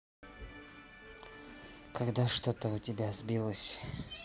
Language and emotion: Russian, neutral